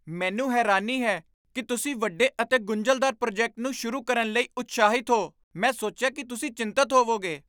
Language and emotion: Punjabi, surprised